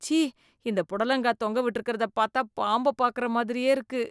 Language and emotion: Tamil, disgusted